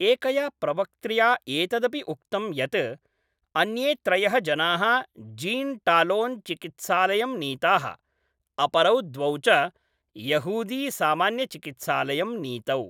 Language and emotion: Sanskrit, neutral